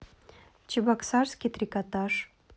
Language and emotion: Russian, neutral